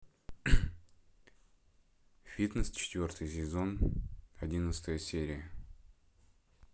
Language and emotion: Russian, neutral